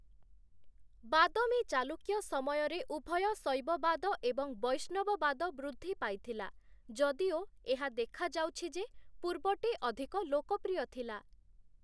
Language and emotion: Odia, neutral